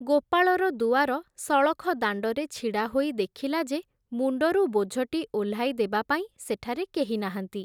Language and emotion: Odia, neutral